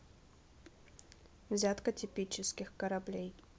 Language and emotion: Russian, neutral